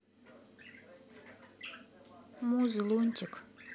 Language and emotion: Russian, neutral